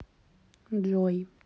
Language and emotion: Russian, neutral